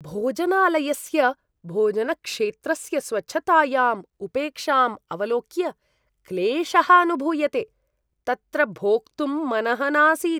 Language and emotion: Sanskrit, disgusted